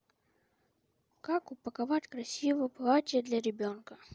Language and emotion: Russian, neutral